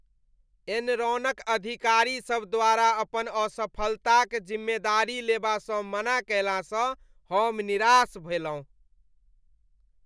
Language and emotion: Maithili, disgusted